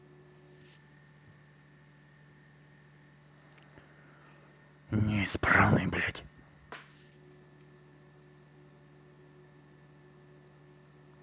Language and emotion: Russian, angry